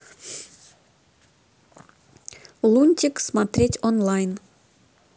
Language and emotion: Russian, neutral